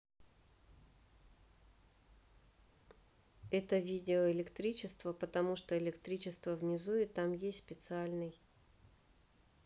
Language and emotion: Russian, neutral